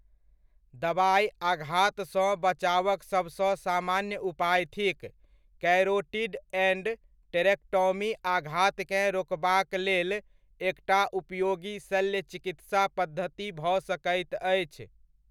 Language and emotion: Maithili, neutral